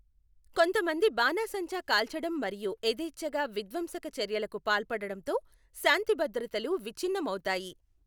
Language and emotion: Telugu, neutral